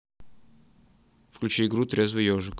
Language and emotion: Russian, neutral